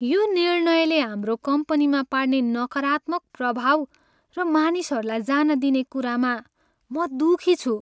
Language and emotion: Nepali, sad